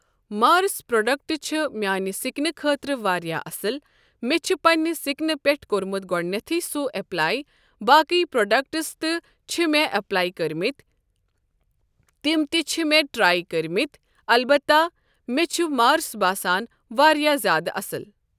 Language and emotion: Kashmiri, neutral